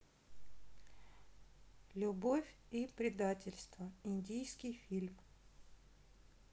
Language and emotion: Russian, neutral